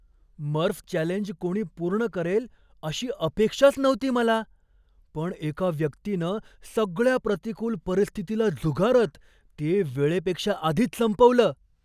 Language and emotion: Marathi, surprised